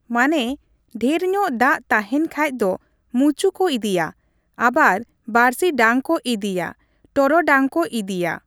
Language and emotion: Santali, neutral